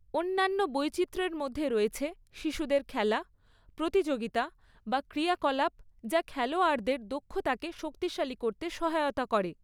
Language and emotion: Bengali, neutral